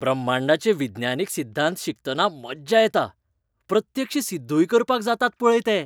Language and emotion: Goan Konkani, happy